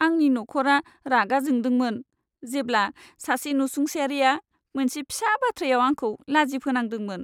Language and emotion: Bodo, sad